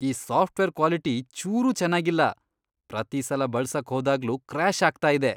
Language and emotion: Kannada, disgusted